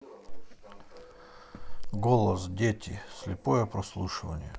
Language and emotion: Russian, neutral